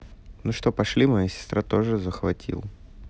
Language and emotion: Russian, neutral